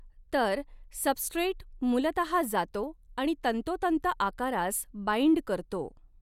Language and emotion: Marathi, neutral